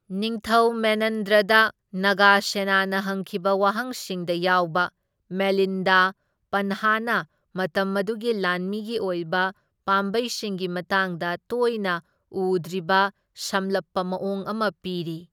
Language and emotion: Manipuri, neutral